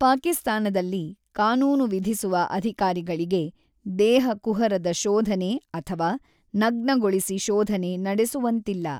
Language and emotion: Kannada, neutral